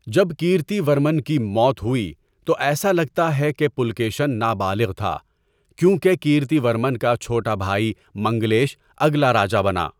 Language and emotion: Urdu, neutral